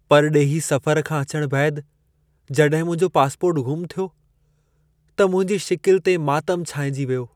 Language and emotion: Sindhi, sad